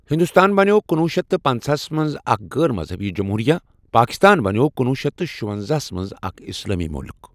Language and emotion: Kashmiri, neutral